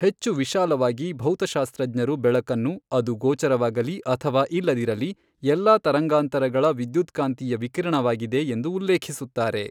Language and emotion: Kannada, neutral